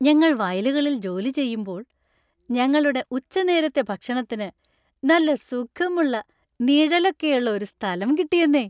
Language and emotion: Malayalam, happy